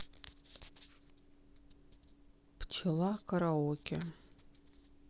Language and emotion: Russian, neutral